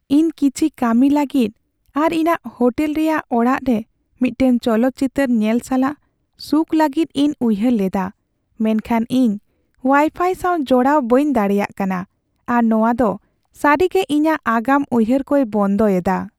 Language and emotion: Santali, sad